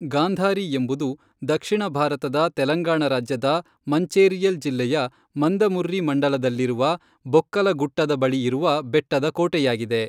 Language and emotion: Kannada, neutral